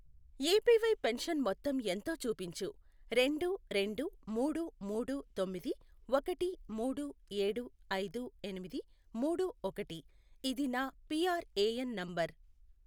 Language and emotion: Telugu, neutral